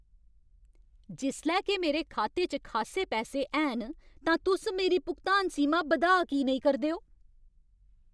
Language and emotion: Dogri, angry